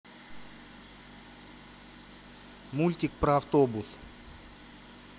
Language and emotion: Russian, neutral